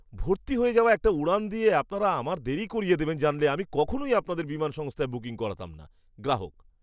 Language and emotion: Bengali, disgusted